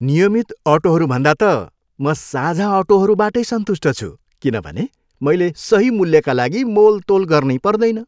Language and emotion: Nepali, happy